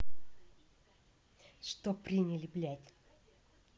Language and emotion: Russian, angry